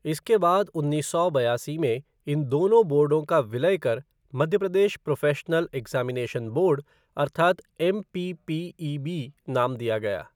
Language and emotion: Hindi, neutral